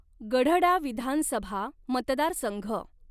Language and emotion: Marathi, neutral